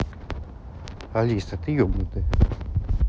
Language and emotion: Russian, angry